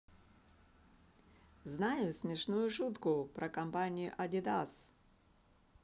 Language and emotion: Russian, positive